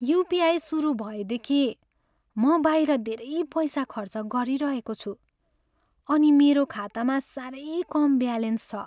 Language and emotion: Nepali, sad